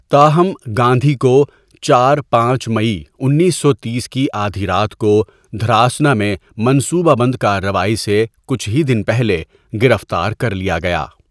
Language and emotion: Urdu, neutral